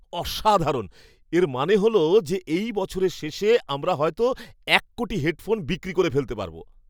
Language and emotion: Bengali, surprised